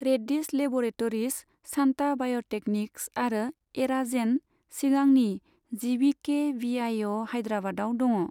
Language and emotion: Bodo, neutral